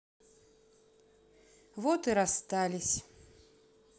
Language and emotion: Russian, sad